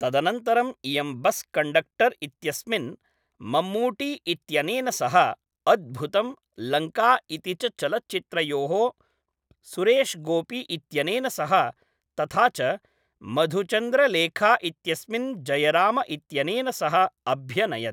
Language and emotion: Sanskrit, neutral